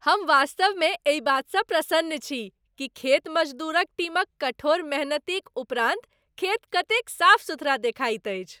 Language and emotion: Maithili, happy